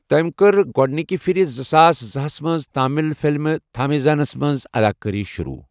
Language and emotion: Kashmiri, neutral